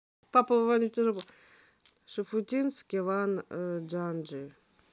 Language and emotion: Russian, neutral